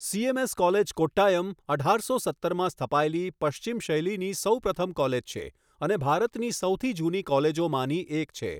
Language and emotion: Gujarati, neutral